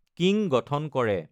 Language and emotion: Assamese, neutral